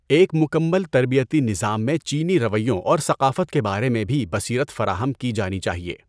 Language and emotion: Urdu, neutral